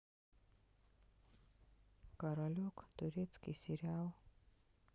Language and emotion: Russian, sad